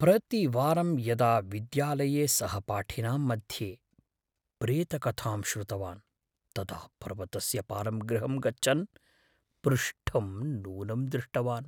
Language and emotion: Sanskrit, fearful